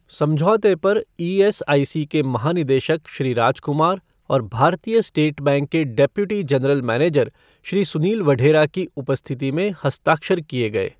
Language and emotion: Hindi, neutral